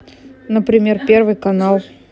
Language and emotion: Russian, neutral